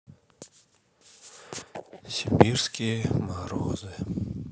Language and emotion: Russian, sad